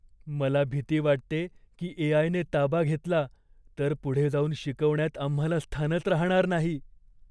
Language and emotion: Marathi, fearful